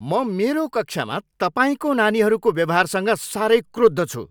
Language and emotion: Nepali, angry